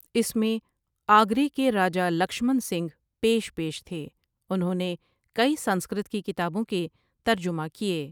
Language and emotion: Urdu, neutral